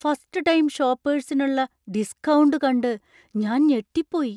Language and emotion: Malayalam, surprised